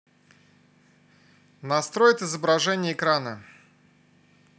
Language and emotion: Russian, neutral